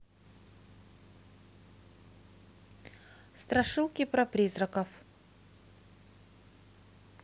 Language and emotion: Russian, neutral